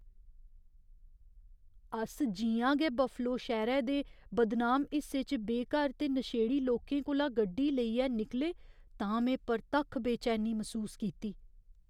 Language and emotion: Dogri, fearful